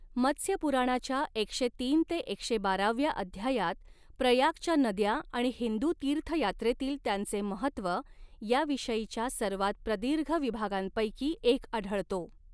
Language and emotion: Marathi, neutral